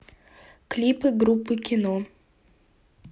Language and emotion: Russian, neutral